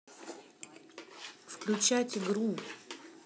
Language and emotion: Russian, neutral